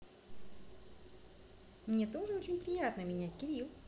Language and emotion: Russian, neutral